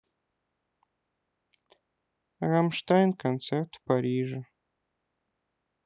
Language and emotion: Russian, sad